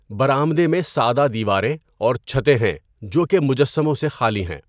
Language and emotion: Urdu, neutral